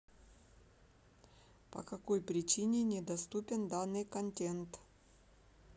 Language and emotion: Russian, neutral